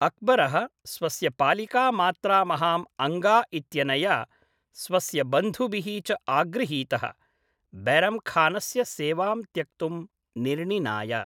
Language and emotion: Sanskrit, neutral